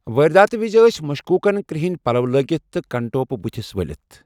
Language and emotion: Kashmiri, neutral